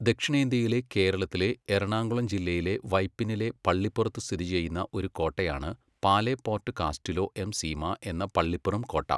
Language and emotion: Malayalam, neutral